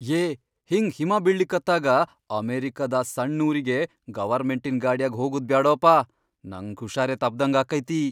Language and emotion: Kannada, fearful